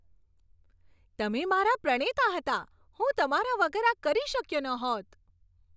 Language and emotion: Gujarati, happy